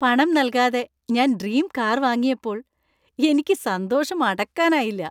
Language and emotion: Malayalam, happy